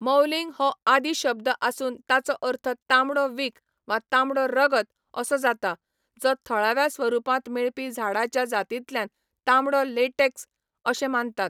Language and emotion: Goan Konkani, neutral